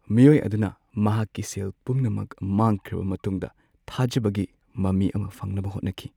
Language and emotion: Manipuri, sad